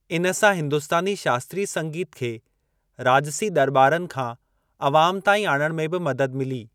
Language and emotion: Sindhi, neutral